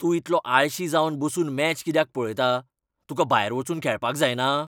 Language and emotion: Goan Konkani, angry